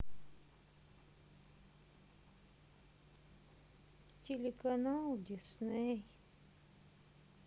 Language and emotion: Russian, sad